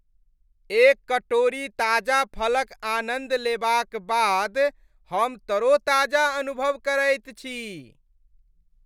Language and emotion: Maithili, happy